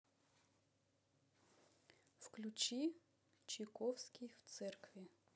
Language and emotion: Russian, neutral